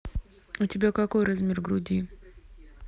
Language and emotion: Russian, neutral